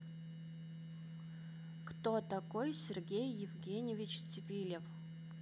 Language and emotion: Russian, neutral